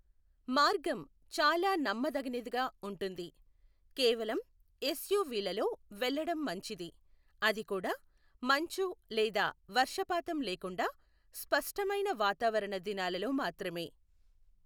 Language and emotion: Telugu, neutral